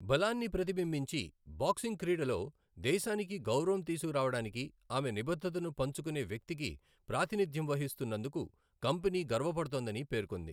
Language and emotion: Telugu, neutral